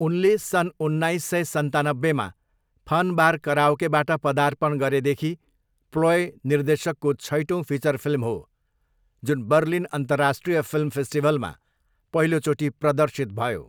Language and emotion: Nepali, neutral